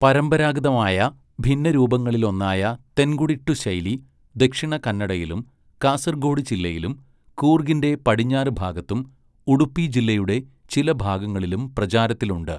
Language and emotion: Malayalam, neutral